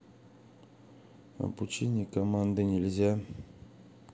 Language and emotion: Russian, sad